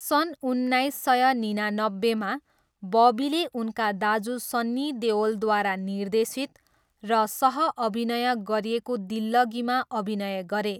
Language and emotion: Nepali, neutral